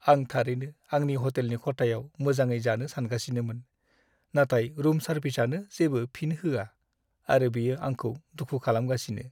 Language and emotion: Bodo, sad